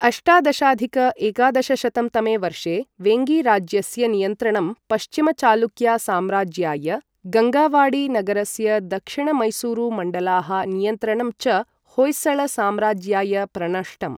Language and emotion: Sanskrit, neutral